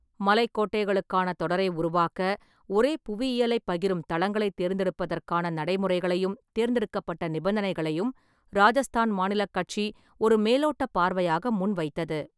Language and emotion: Tamil, neutral